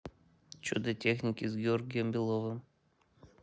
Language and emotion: Russian, neutral